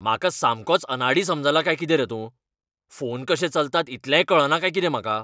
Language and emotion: Goan Konkani, angry